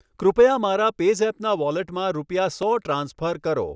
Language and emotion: Gujarati, neutral